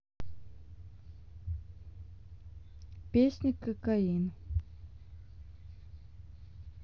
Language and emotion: Russian, neutral